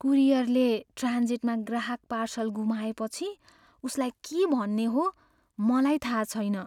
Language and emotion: Nepali, fearful